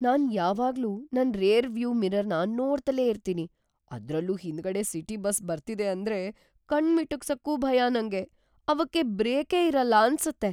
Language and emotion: Kannada, fearful